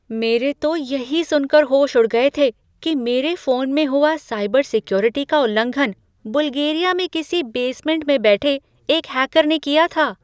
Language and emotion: Hindi, surprised